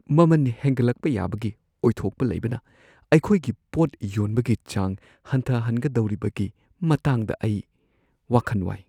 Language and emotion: Manipuri, fearful